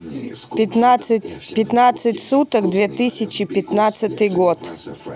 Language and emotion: Russian, neutral